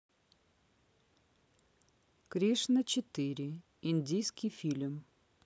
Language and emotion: Russian, neutral